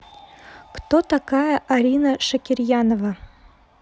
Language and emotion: Russian, neutral